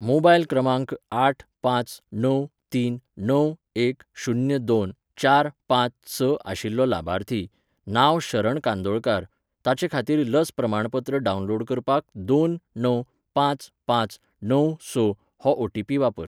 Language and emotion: Goan Konkani, neutral